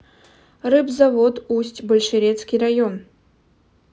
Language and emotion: Russian, neutral